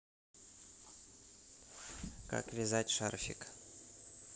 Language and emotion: Russian, neutral